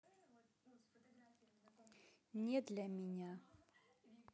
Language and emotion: Russian, neutral